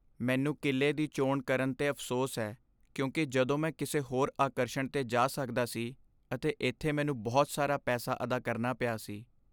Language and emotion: Punjabi, sad